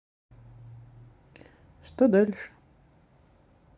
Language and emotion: Russian, neutral